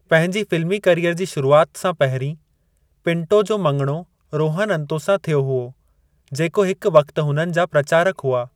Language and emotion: Sindhi, neutral